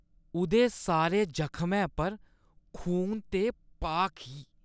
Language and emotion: Dogri, disgusted